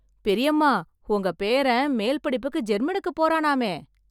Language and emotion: Tamil, happy